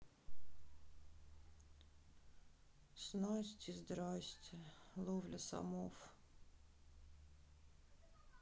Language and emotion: Russian, sad